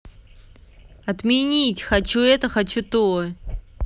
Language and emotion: Russian, angry